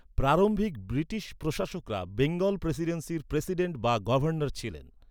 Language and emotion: Bengali, neutral